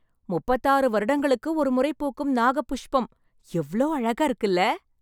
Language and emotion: Tamil, happy